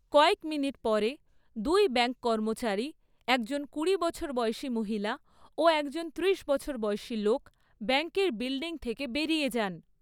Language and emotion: Bengali, neutral